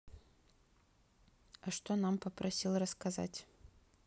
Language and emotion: Russian, neutral